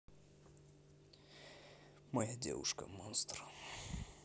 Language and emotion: Russian, neutral